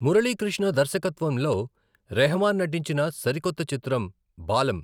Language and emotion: Telugu, neutral